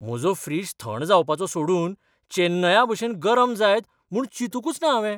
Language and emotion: Goan Konkani, surprised